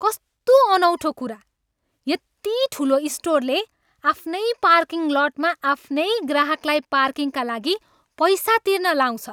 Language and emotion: Nepali, angry